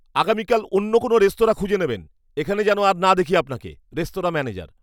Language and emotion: Bengali, angry